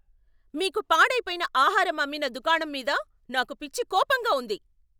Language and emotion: Telugu, angry